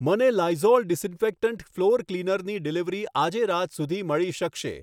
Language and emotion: Gujarati, neutral